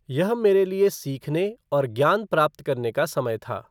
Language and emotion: Hindi, neutral